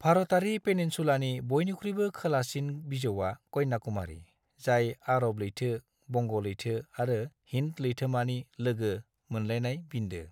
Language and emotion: Bodo, neutral